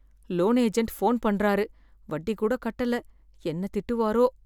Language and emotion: Tamil, fearful